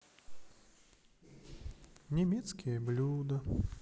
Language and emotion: Russian, sad